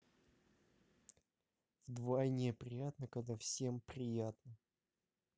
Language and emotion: Russian, neutral